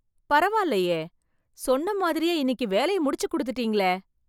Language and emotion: Tamil, surprised